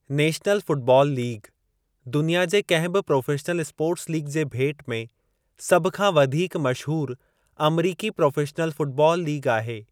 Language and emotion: Sindhi, neutral